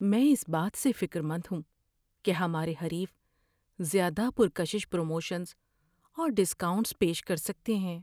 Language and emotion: Urdu, fearful